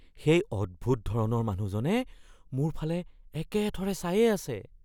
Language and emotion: Assamese, fearful